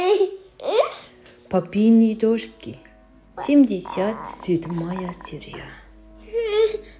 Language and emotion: Russian, positive